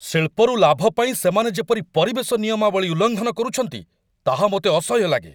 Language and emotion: Odia, angry